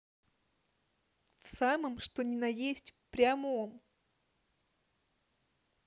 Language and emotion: Russian, neutral